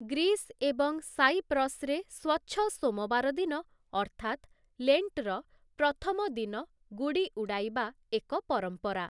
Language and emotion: Odia, neutral